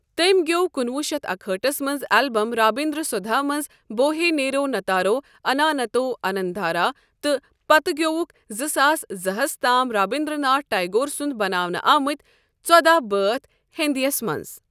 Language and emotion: Kashmiri, neutral